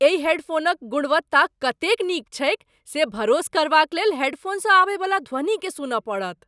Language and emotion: Maithili, surprised